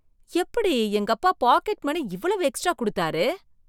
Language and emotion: Tamil, surprised